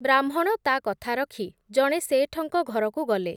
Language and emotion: Odia, neutral